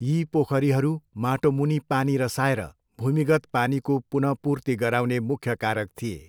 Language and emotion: Nepali, neutral